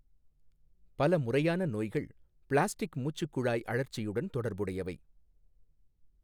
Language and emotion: Tamil, neutral